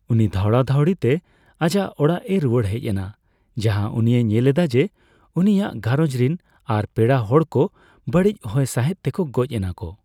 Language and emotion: Santali, neutral